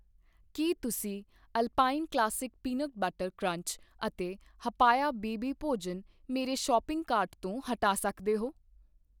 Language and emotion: Punjabi, neutral